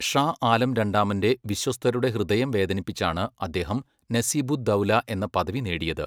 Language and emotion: Malayalam, neutral